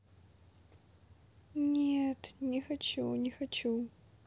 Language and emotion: Russian, sad